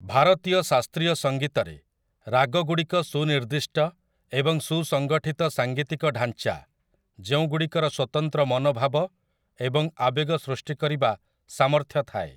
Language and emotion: Odia, neutral